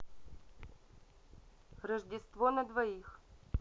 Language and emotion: Russian, neutral